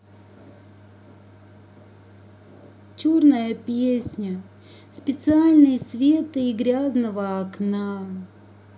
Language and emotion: Russian, neutral